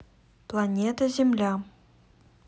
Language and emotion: Russian, neutral